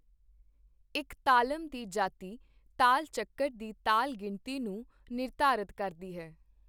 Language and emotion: Punjabi, neutral